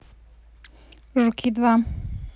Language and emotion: Russian, neutral